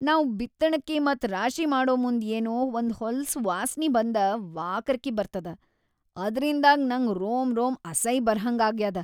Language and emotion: Kannada, disgusted